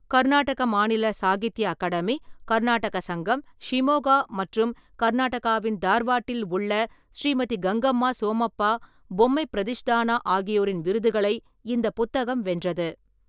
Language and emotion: Tamil, neutral